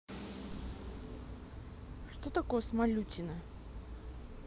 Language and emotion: Russian, neutral